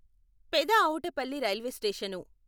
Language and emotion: Telugu, neutral